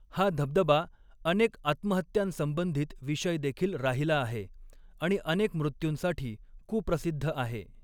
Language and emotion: Marathi, neutral